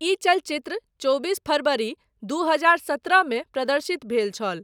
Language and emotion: Maithili, neutral